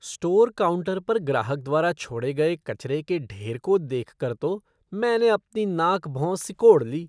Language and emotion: Hindi, disgusted